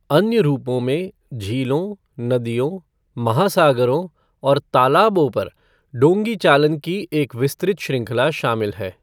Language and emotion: Hindi, neutral